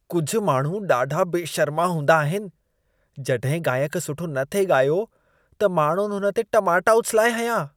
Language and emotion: Sindhi, disgusted